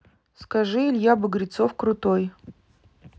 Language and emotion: Russian, neutral